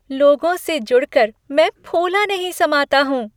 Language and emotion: Hindi, happy